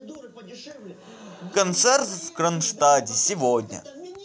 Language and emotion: Russian, neutral